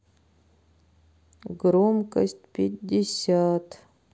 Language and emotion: Russian, sad